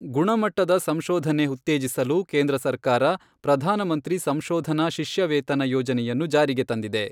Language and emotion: Kannada, neutral